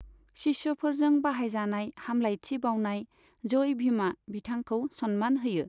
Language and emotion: Bodo, neutral